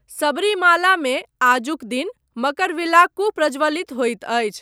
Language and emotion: Maithili, neutral